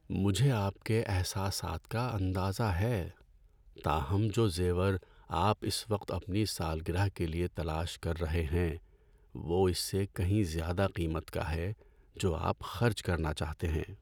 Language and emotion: Urdu, sad